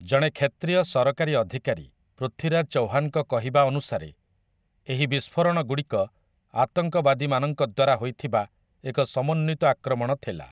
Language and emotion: Odia, neutral